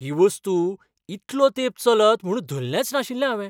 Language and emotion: Goan Konkani, surprised